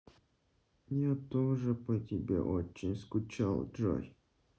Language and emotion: Russian, sad